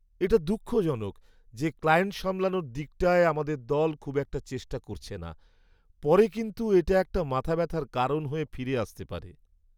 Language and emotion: Bengali, sad